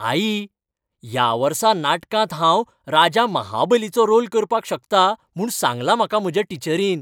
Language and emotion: Goan Konkani, happy